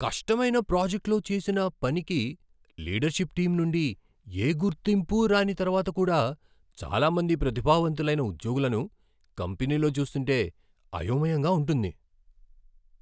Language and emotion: Telugu, surprised